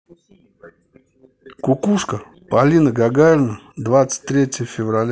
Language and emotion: Russian, neutral